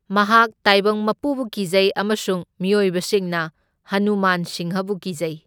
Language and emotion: Manipuri, neutral